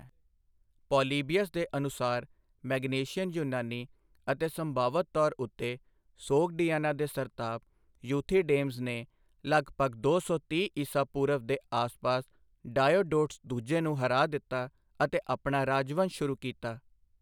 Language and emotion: Punjabi, neutral